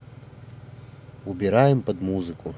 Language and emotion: Russian, neutral